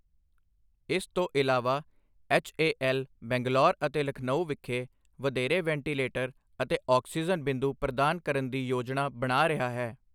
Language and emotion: Punjabi, neutral